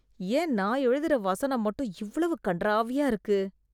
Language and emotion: Tamil, disgusted